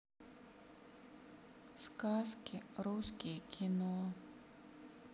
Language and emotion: Russian, sad